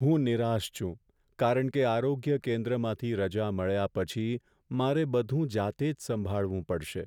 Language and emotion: Gujarati, sad